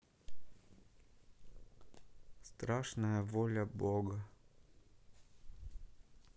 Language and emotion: Russian, sad